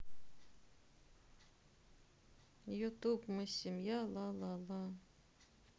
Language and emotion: Russian, sad